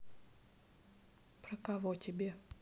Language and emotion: Russian, neutral